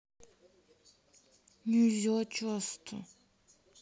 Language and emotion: Russian, sad